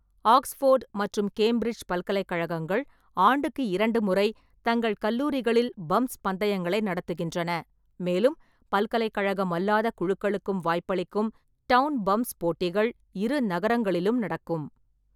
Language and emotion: Tamil, neutral